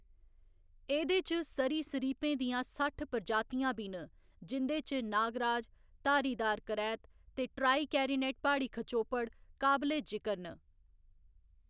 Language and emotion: Dogri, neutral